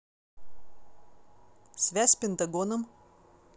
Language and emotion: Russian, neutral